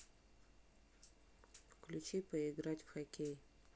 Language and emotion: Russian, neutral